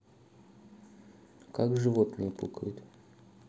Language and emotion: Russian, neutral